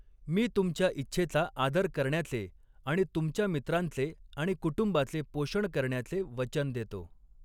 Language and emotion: Marathi, neutral